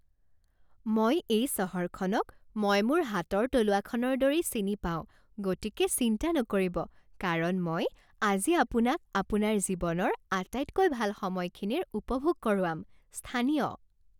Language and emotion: Assamese, happy